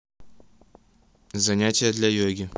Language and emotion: Russian, neutral